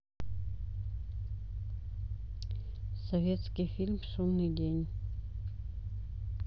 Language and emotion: Russian, neutral